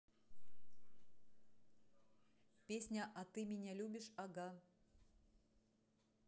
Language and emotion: Russian, neutral